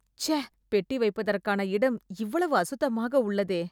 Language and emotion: Tamil, disgusted